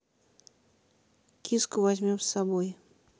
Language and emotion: Russian, neutral